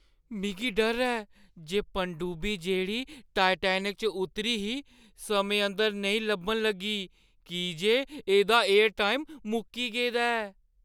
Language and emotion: Dogri, fearful